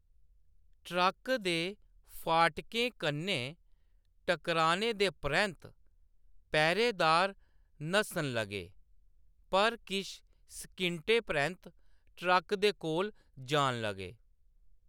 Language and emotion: Dogri, neutral